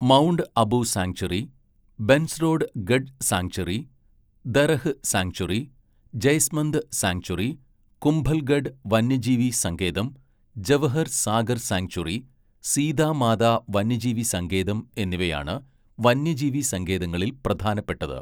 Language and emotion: Malayalam, neutral